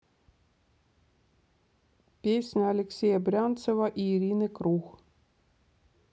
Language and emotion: Russian, neutral